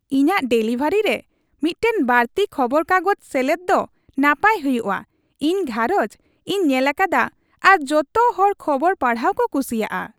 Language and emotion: Santali, happy